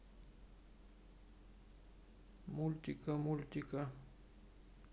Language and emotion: Russian, neutral